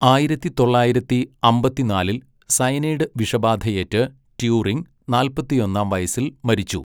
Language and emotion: Malayalam, neutral